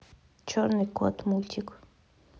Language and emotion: Russian, neutral